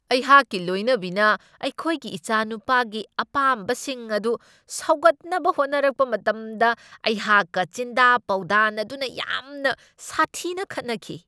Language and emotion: Manipuri, angry